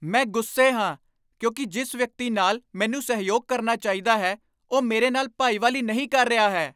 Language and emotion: Punjabi, angry